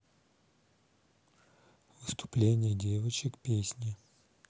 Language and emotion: Russian, neutral